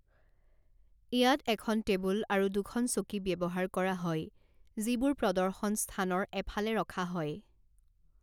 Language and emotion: Assamese, neutral